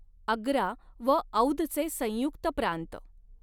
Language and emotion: Marathi, neutral